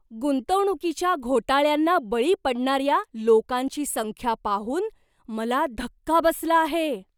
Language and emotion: Marathi, surprised